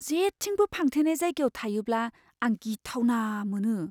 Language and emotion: Bodo, fearful